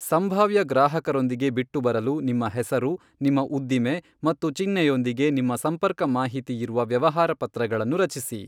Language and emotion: Kannada, neutral